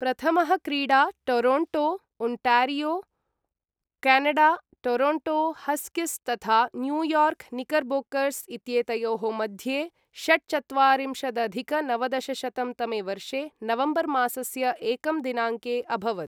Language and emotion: Sanskrit, neutral